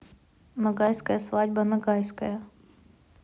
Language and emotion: Russian, neutral